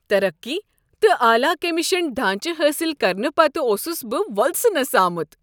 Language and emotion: Kashmiri, happy